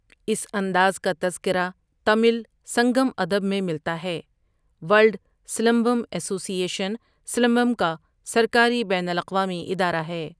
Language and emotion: Urdu, neutral